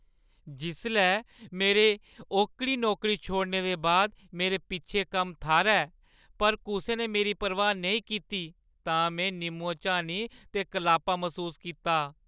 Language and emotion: Dogri, sad